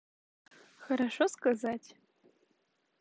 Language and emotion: Russian, positive